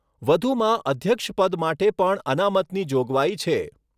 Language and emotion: Gujarati, neutral